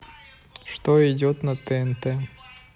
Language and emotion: Russian, neutral